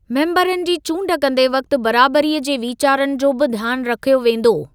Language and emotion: Sindhi, neutral